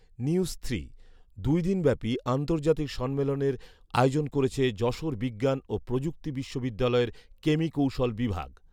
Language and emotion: Bengali, neutral